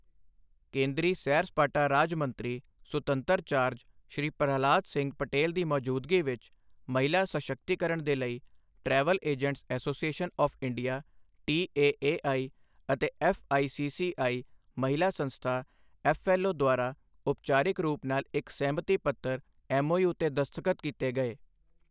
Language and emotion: Punjabi, neutral